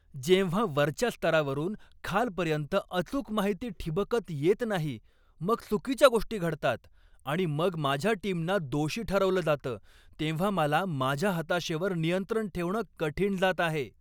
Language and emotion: Marathi, angry